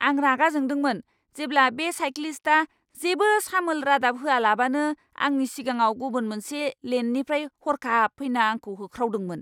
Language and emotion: Bodo, angry